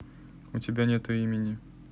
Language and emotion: Russian, neutral